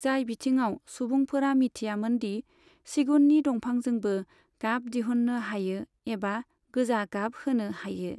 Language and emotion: Bodo, neutral